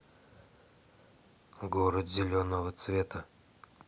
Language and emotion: Russian, neutral